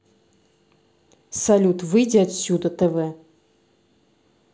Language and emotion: Russian, angry